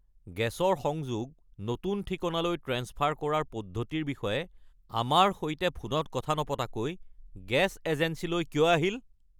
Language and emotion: Assamese, angry